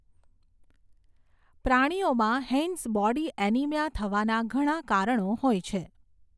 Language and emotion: Gujarati, neutral